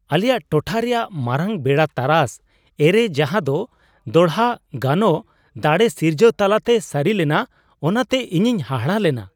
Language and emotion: Santali, surprised